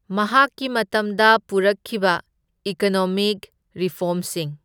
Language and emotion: Manipuri, neutral